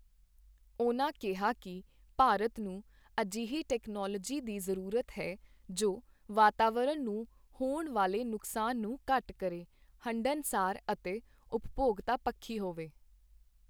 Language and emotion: Punjabi, neutral